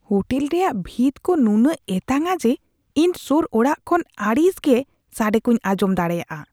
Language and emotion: Santali, disgusted